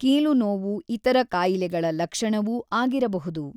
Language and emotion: Kannada, neutral